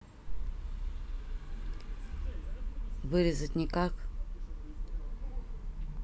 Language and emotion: Russian, neutral